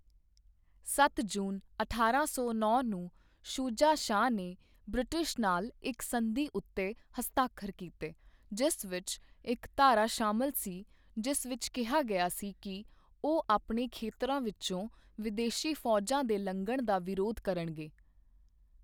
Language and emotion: Punjabi, neutral